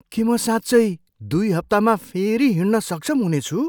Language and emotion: Nepali, surprised